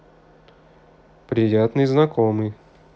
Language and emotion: Russian, positive